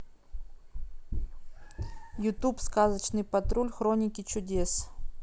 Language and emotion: Russian, neutral